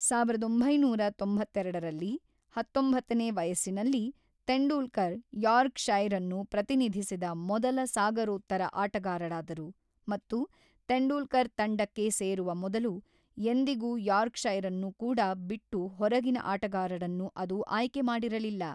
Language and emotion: Kannada, neutral